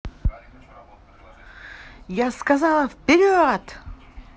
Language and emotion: Russian, positive